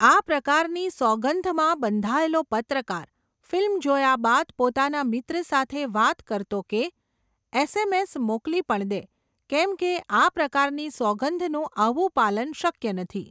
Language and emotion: Gujarati, neutral